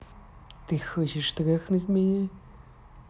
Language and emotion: Russian, angry